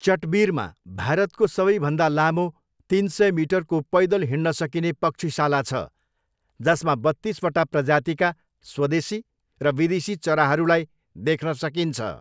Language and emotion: Nepali, neutral